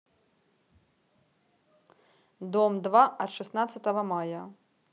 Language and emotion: Russian, neutral